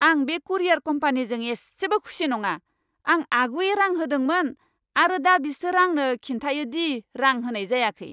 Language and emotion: Bodo, angry